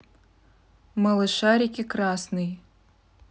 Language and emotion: Russian, neutral